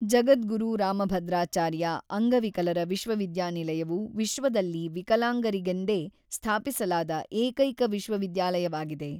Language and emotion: Kannada, neutral